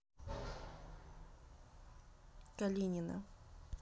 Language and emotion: Russian, neutral